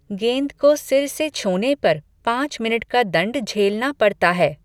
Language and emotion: Hindi, neutral